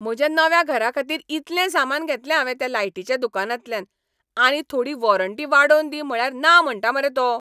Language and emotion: Goan Konkani, angry